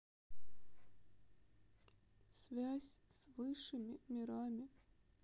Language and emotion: Russian, sad